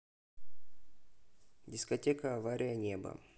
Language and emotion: Russian, neutral